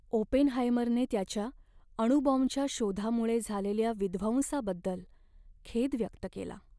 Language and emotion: Marathi, sad